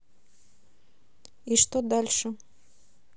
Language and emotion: Russian, neutral